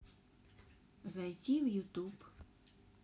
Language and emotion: Russian, neutral